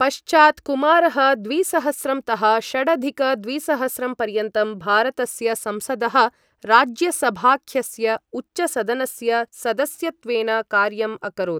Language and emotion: Sanskrit, neutral